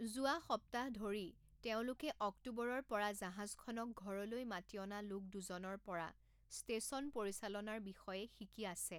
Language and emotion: Assamese, neutral